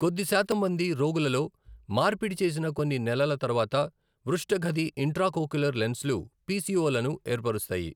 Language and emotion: Telugu, neutral